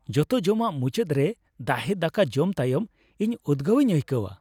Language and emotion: Santali, happy